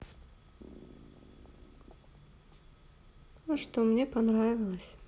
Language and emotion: Russian, sad